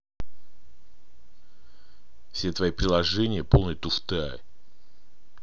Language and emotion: Russian, angry